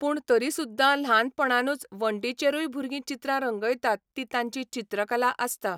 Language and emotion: Goan Konkani, neutral